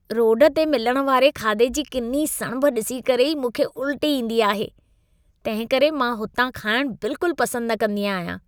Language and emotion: Sindhi, disgusted